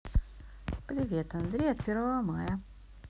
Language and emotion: Russian, neutral